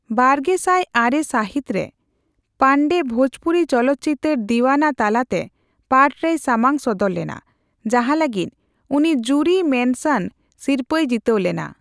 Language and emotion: Santali, neutral